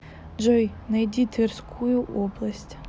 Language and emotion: Russian, neutral